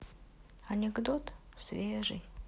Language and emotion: Russian, sad